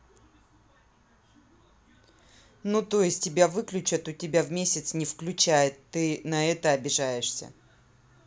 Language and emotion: Russian, neutral